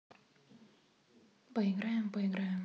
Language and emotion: Russian, neutral